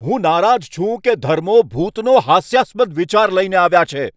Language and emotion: Gujarati, angry